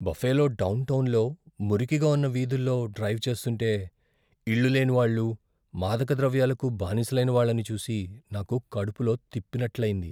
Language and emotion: Telugu, fearful